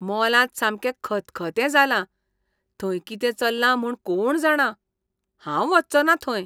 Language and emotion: Goan Konkani, disgusted